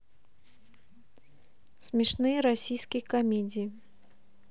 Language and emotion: Russian, neutral